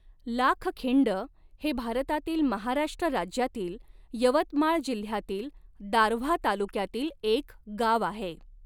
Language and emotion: Marathi, neutral